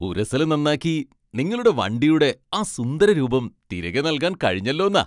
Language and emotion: Malayalam, happy